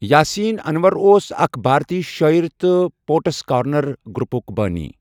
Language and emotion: Kashmiri, neutral